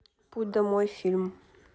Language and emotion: Russian, neutral